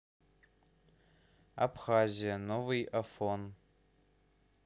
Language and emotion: Russian, neutral